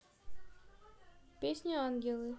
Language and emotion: Russian, neutral